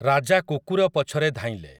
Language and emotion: Odia, neutral